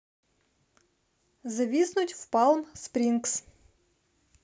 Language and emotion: Russian, neutral